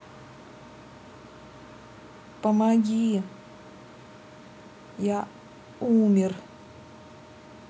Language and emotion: Russian, sad